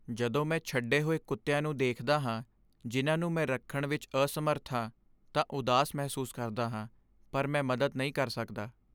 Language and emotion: Punjabi, sad